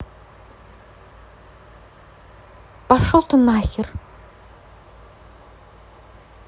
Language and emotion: Russian, angry